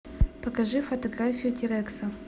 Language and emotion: Russian, neutral